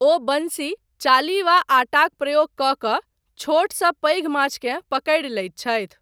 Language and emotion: Maithili, neutral